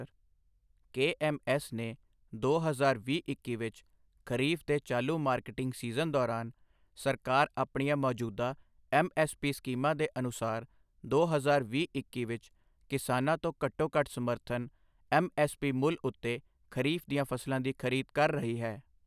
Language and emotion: Punjabi, neutral